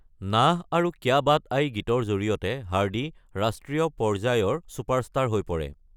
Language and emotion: Assamese, neutral